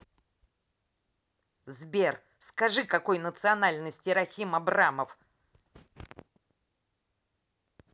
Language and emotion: Russian, angry